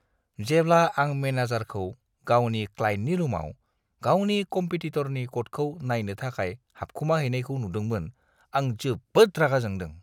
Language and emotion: Bodo, disgusted